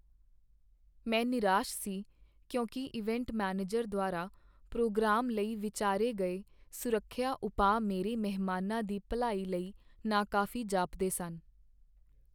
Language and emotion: Punjabi, sad